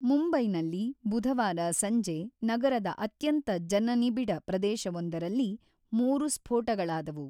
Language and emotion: Kannada, neutral